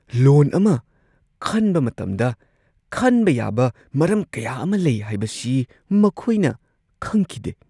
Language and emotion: Manipuri, surprised